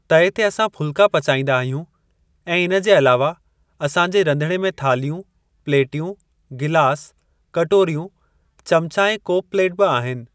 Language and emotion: Sindhi, neutral